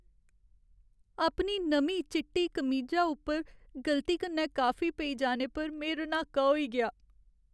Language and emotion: Dogri, sad